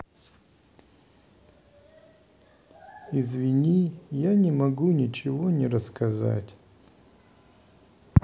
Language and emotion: Russian, sad